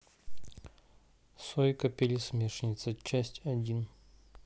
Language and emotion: Russian, neutral